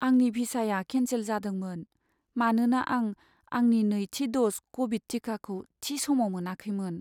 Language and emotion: Bodo, sad